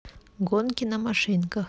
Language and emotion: Russian, neutral